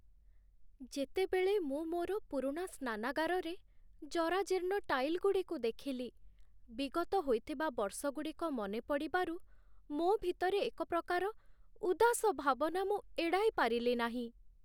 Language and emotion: Odia, sad